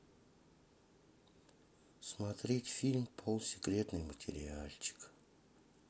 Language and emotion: Russian, sad